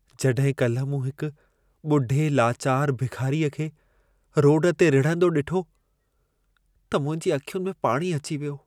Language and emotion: Sindhi, sad